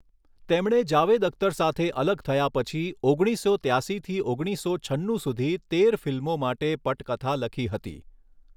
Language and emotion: Gujarati, neutral